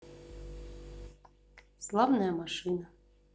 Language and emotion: Russian, sad